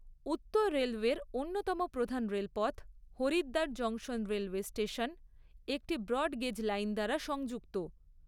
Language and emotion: Bengali, neutral